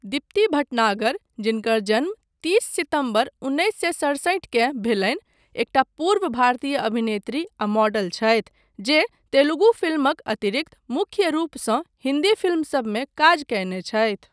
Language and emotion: Maithili, neutral